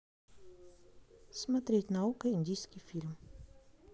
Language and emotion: Russian, neutral